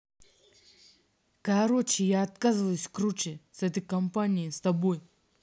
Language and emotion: Russian, angry